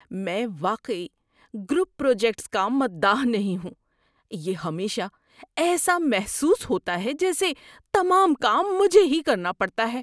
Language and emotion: Urdu, disgusted